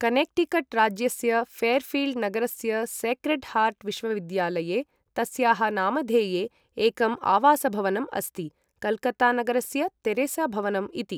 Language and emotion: Sanskrit, neutral